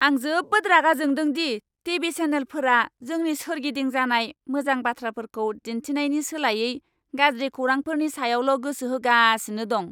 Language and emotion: Bodo, angry